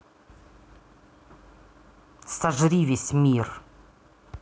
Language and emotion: Russian, angry